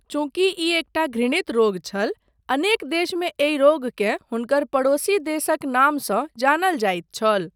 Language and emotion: Maithili, neutral